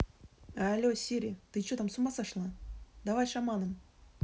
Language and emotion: Russian, angry